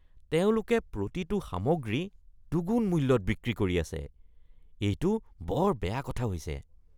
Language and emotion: Assamese, disgusted